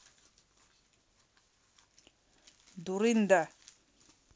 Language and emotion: Russian, angry